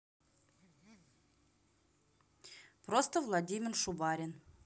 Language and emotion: Russian, neutral